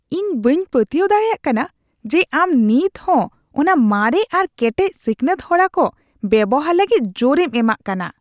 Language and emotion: Santali, disgusted